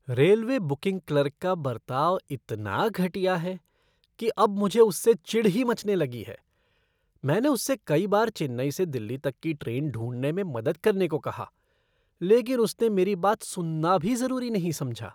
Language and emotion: Hindi, disgusted